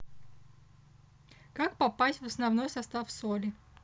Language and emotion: Russian, neutral